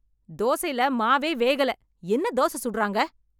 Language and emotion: Tamil, angry